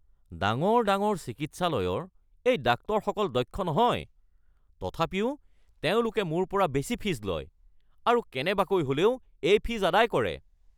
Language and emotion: Assamese, angry